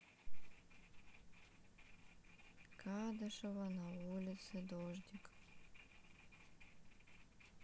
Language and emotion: Russian, sad